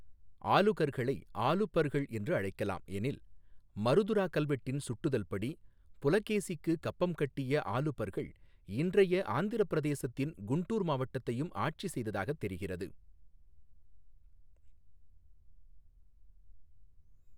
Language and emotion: Tamil, neutral